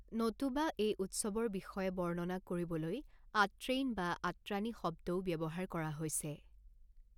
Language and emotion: Assamese, neutral